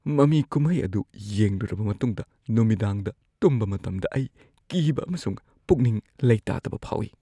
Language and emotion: Manipuri, fearful